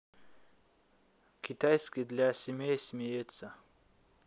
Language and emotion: Russian, neutral